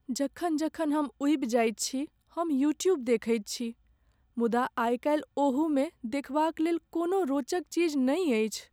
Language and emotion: Maithili, sad